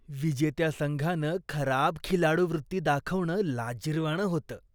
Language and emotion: Marathi, disgusted